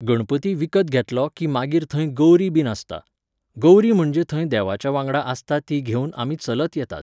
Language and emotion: Goan Konkani, neutral